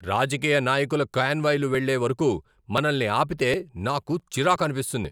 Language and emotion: Telugu, angry